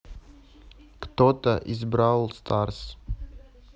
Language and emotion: Russian, neutral